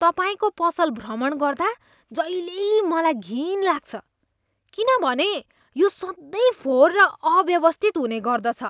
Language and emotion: Nepali, disgusted